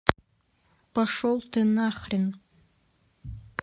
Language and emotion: Russian, angry